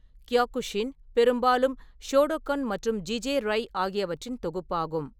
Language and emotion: Tamil, neutral